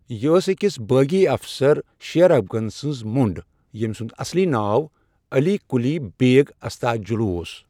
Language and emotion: Kashmiri, neutral